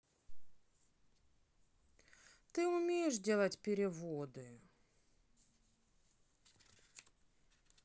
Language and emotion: Russian, sad